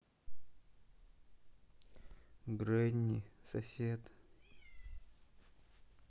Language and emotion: Russian, sad